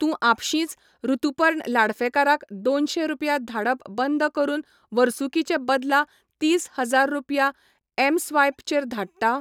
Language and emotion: Goan Konkani, neutral